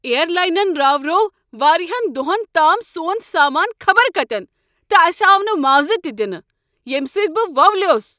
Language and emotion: Kashmiri, angry